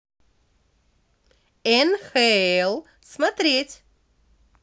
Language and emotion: Russian, positive